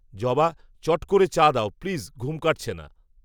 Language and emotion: Bengali, neutral